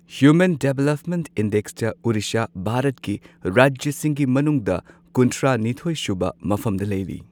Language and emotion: Manipuri, neutral